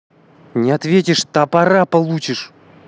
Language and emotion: Russian, angry